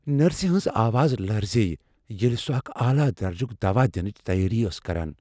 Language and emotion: Kashmiri, fearful